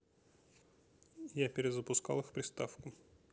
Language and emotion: Russian, neutral